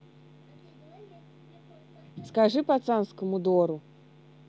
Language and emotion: Russian, neutral